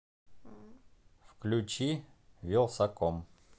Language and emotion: Russian, neutral